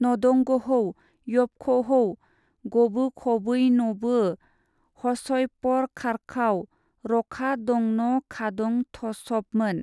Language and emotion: Bodo, neutral